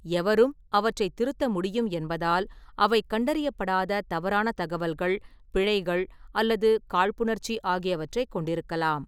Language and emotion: Tamil, neutral